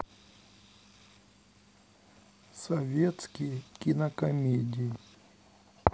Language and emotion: Russian, sad